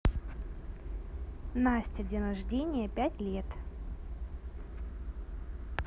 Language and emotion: Russian, neutral